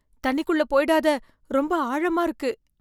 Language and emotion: Tamil, fearful